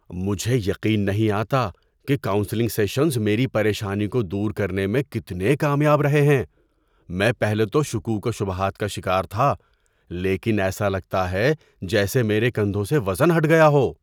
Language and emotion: Urdu, surprised